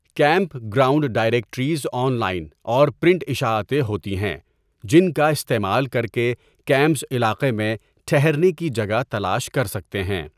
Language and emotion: Urdu, neutral